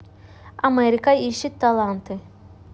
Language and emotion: Russian, neutral